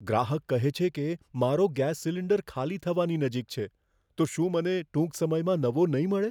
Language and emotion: Gujarati, fearful